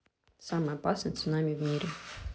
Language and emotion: Russian, neutral